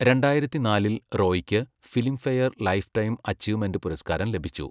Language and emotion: Malayalam, neutral